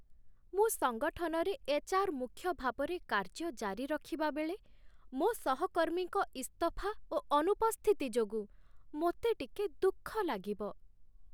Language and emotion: Odia, sad